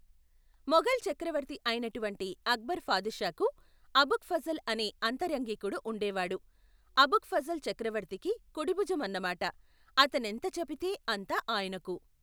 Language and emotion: Telugu, neutral